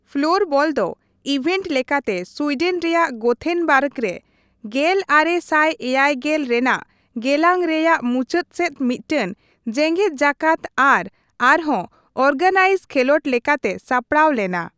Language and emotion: Santali, neutral